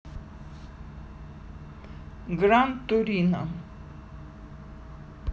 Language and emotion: Russian, neutral